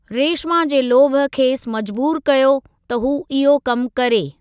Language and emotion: Sindhi, neutral